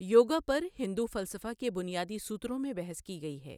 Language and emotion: Urdu, neutral